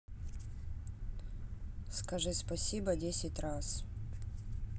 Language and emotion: Russian, neutral